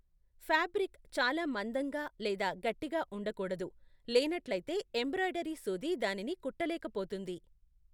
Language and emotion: Telugu, neutral